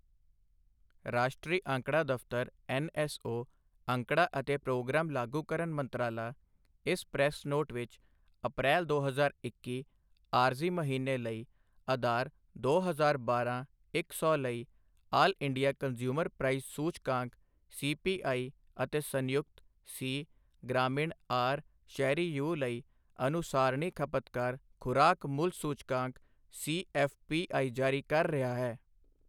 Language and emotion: Punjabi, neutral